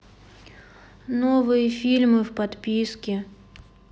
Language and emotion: Russian, sad